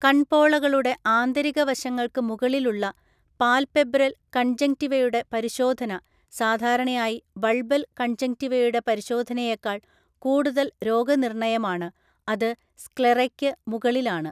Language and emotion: Malayalam, neutral